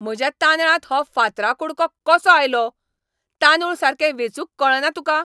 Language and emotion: Goan Konkani, angry